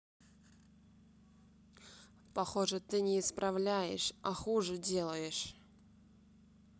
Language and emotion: Russian, neutral